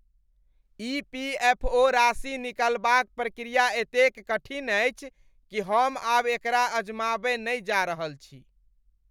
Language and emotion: Maithili, disgusted